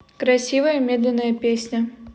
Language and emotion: Russian, neutral